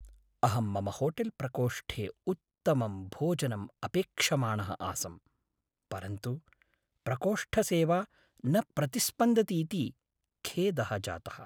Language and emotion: Sanskrit, sad